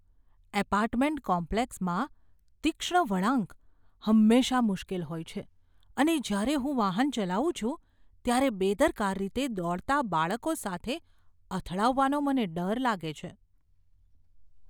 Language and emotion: Gujarati, fearful